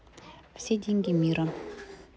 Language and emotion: Russian, neutral